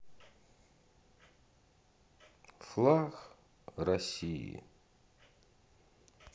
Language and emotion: Russian, sad